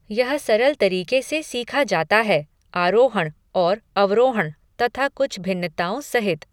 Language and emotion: Hindi, neutral